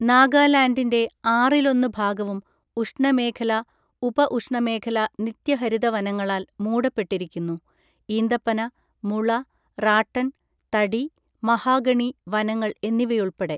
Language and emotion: Malayalam, neutral